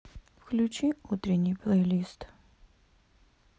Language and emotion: Russian, sad